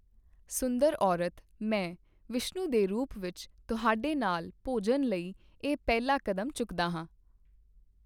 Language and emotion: Punjabi, neutral